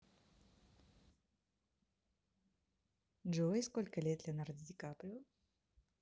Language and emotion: Russian, positive